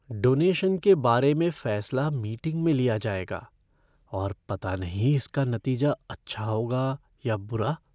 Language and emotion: Hindi, fearful